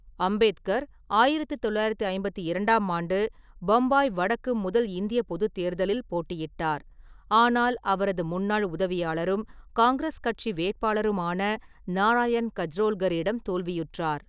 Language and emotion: Tamil, neutral